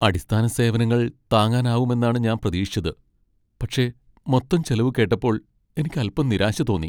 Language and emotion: Malayalam, sad